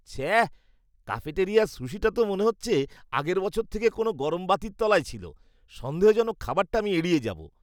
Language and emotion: Bengali, disgusted